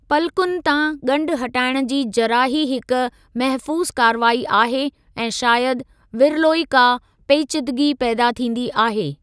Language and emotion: Sindhi, neutral